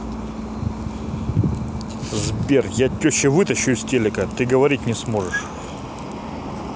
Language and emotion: Russian, angry